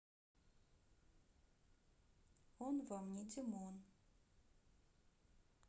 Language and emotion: Russian, neutral